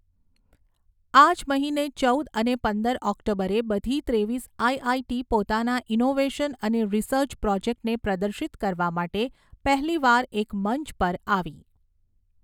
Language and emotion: Gujarati, neutral